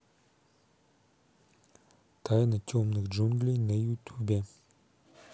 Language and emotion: Russian, neutral